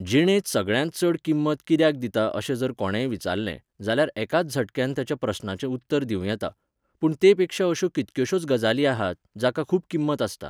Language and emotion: Goan Konkani, neutral